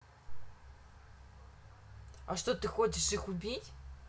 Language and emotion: Russian, neutral